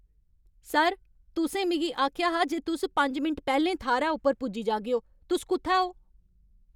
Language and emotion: Dogri, angry